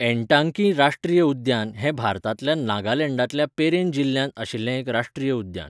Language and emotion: Goan Konkani, neutral